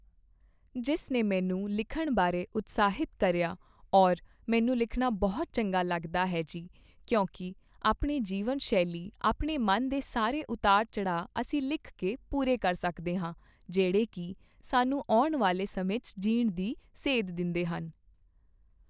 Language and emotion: Punjabi, neutral